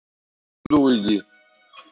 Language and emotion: Russian, neutral